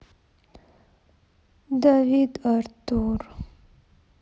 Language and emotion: Russian, sad